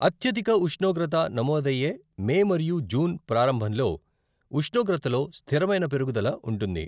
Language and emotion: Telugu, neutral